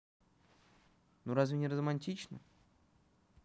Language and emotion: Russian, neutral